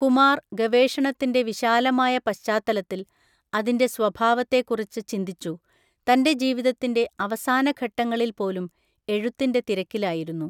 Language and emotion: Malayalam, neutral